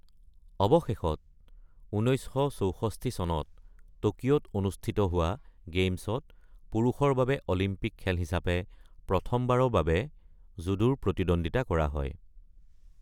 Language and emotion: Assamese, neutral